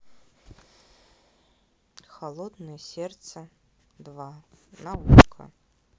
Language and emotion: Russian, neutral